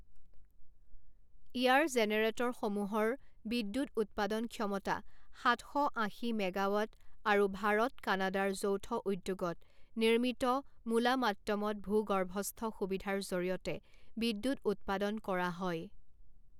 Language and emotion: Assamese, neutral